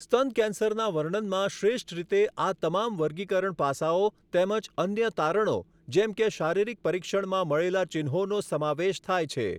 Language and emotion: Gujarati, neutral